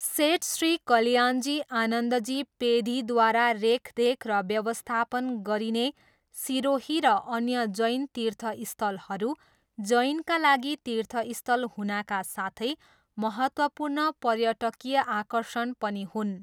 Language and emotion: Nepali, neutral